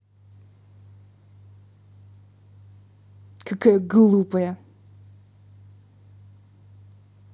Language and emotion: Russian, angry